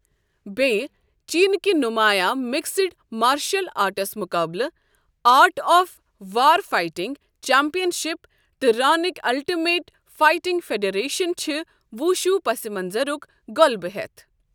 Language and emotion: Kashmiri, neutral